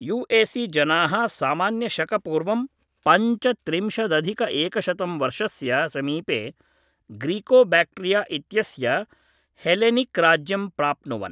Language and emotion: Sanskrit, neutral